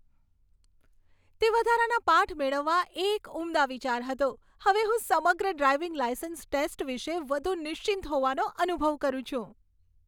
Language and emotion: Gujarati, happy